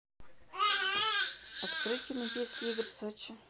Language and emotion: Russian, neutral